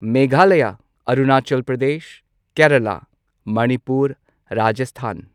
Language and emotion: Manipuri, neutral